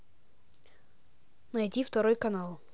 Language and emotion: Russian, neutral